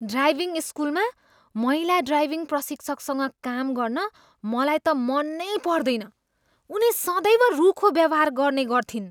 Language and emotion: Nepali, disgusted